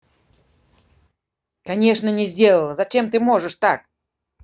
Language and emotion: Russian, angry